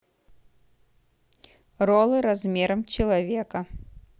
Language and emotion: Russian, neutral